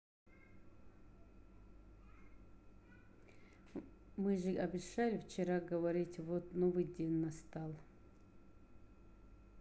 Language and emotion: Russian, neutral